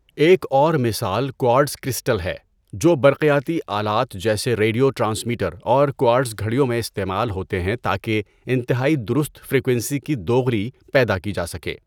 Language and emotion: Urdu, neutral